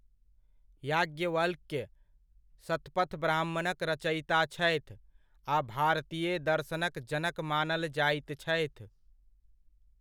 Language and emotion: Maithili, neutral